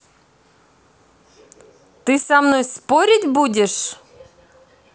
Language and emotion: Russian, angry